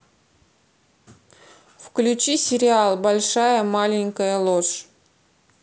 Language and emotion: Russian, neutral